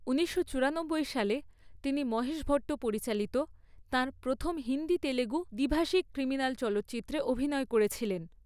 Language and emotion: Bengali, neutral